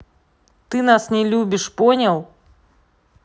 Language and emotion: Russian, angry